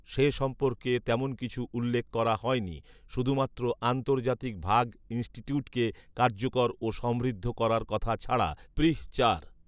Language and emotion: Bengali, neutral